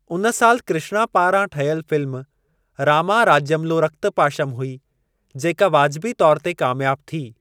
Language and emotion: Sindhi, neutral